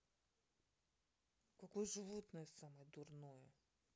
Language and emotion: Russian, angry